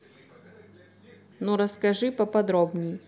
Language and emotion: Russian, neutral